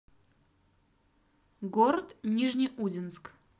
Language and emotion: Russian, neutral